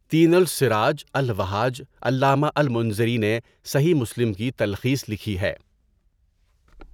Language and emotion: Urdu, neutral